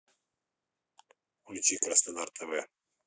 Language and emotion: Russian, neutral